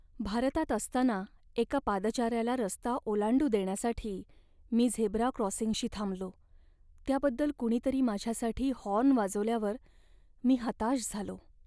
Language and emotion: Marathi, sad